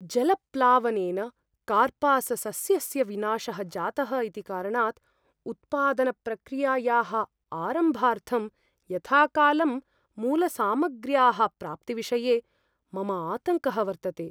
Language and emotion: Sanskrit, fearful